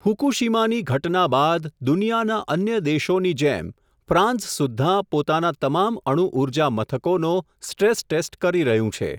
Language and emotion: Gujarati, neutral